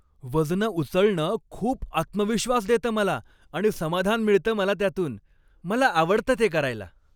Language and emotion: Marathi, happy